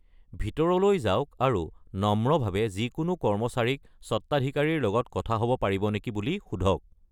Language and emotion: Assamese, neutral